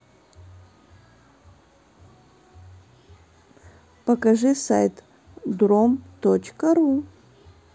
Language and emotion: Russian, neutral